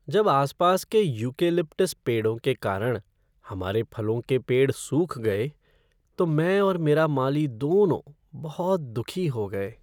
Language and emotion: Hindi, sad